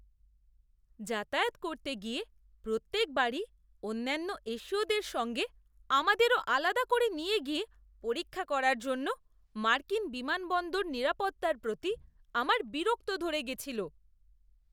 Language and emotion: Bengali, disgusted